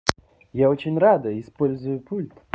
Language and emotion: Russian, positive